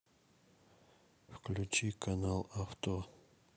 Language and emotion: Russian, neutral